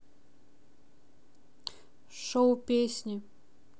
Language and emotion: Russian, neutral